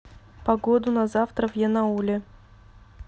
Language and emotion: Russian, neutral